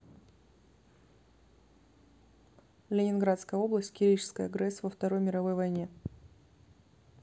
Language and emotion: Russian, neutral